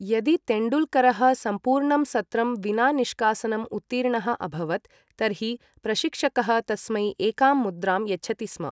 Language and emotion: Sanskrit, neutral